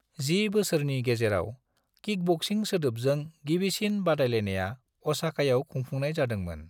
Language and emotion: Bodo, neutral